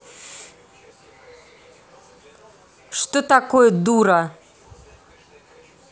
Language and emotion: Russian, angry